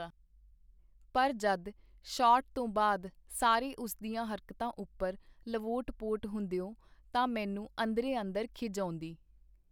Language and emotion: Punjabi, neutral